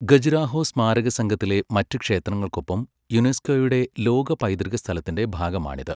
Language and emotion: Malayalam, neutral